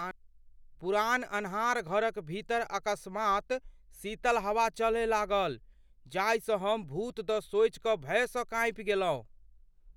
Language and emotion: Maithili, fearful